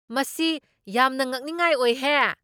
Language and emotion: Manipuri, surprised